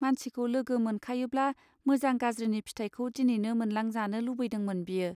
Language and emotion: Bodo, neutral